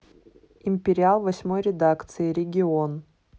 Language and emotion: Russian, neutral